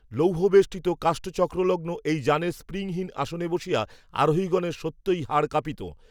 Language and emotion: Bengali, neutral